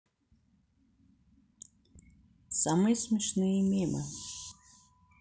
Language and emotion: Russian, neutral